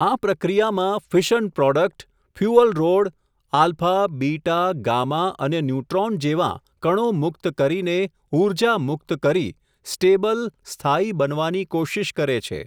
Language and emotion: Gujarati, neutral